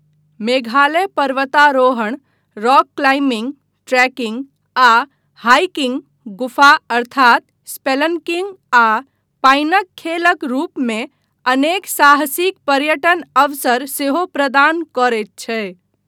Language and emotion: Maithili, neutral